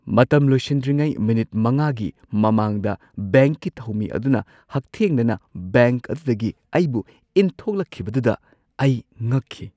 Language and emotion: Manipuri, surprised